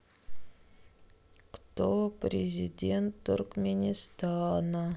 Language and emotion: Russian, neutral